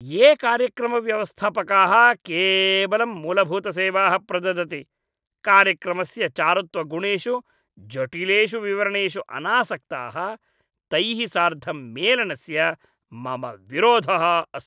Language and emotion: Sanskrit, disgusted